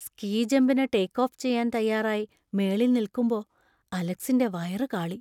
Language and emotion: Malayalam, fearful